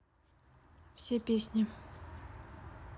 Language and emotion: Russian, neutral